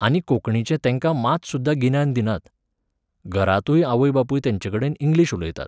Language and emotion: Goan Konkani, neutral